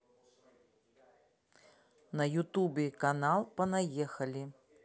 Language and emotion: Russian, neutral